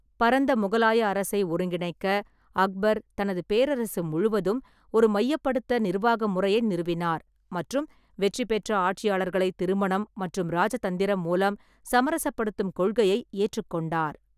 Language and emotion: Tamil, neutral